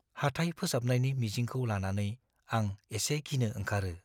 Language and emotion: Bodo, fearful